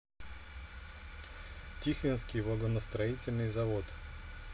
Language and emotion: Russian, neutral